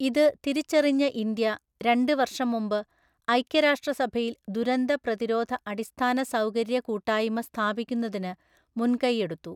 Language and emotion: Malayalam, neutral